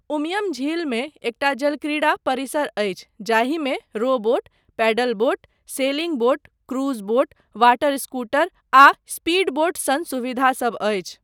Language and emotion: Maithili, neutral